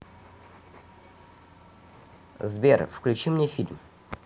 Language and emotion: Russian, neutral